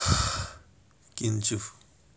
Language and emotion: Russian, neutral